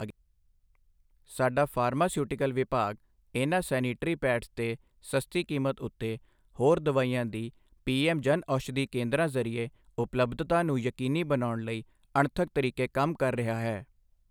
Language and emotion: Punjabi, neutral